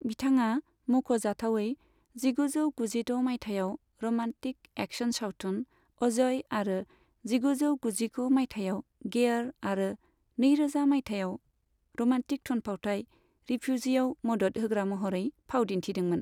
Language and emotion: Bodo, neutral